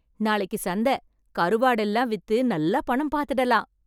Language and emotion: Tamil, happy